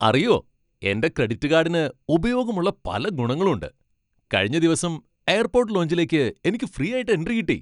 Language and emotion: Malayalam, happy